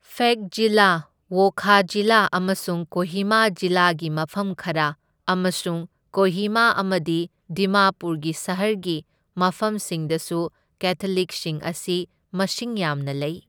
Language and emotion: Manipuri, neutral